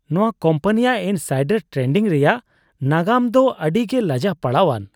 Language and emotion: Santali, disgusted